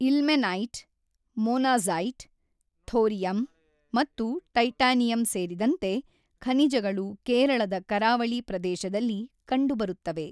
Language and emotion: Kannada, neutral